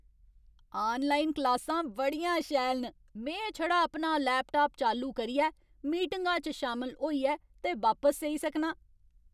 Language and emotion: Dogri, happy